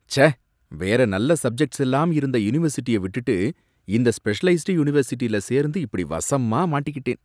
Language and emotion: Tamil, disgusted